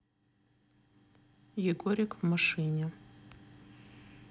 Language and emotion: Russian, neutral